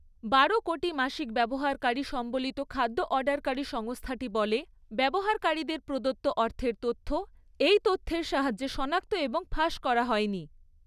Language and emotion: Bengali, neutral